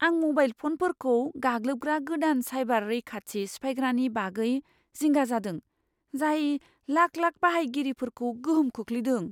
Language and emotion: Bodo, fearful